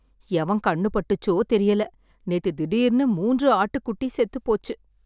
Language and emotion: Tamil, sad